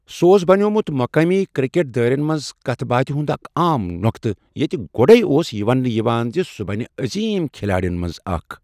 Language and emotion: Kashmiri, neutral